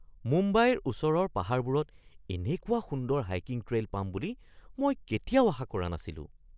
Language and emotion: Assamese, surprised